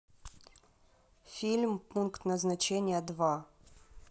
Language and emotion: Russian, neutral